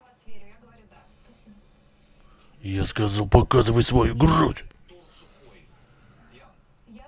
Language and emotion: Russian, angry